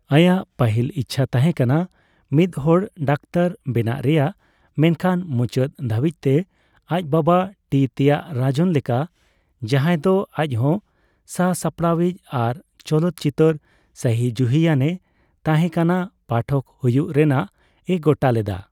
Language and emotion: Santali, neutral